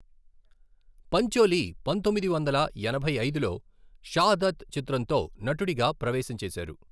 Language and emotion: Telugu, neutral